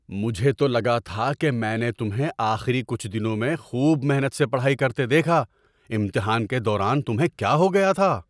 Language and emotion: Urdu, surprised